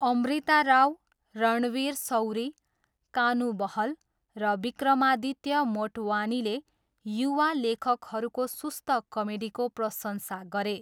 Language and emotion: Nepali, neutral